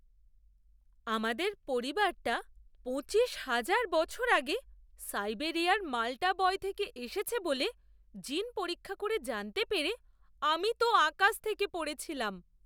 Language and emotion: Bengali, surprised